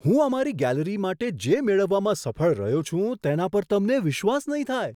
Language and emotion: Gujarati, surprised